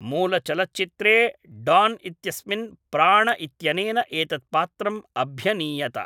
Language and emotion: Sanskrit, neutral